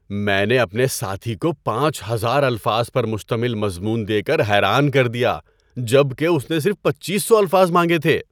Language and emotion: Urdu, surprised